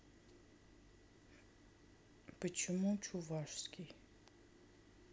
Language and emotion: Russian, sad